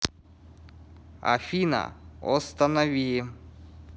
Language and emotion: Russian, neutral